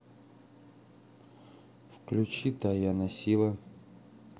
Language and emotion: Russian, neutral